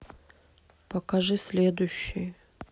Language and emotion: Russian, neutral